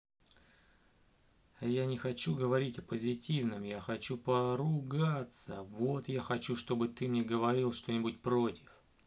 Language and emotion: Russian, neutral